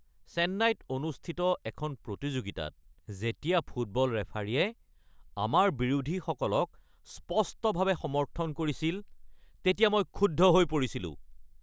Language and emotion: Assamese, angry